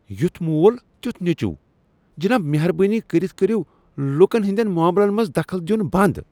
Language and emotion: Kashmiri, disgusted